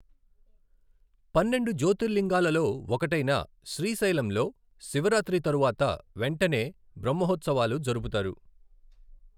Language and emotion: Telugu, neutral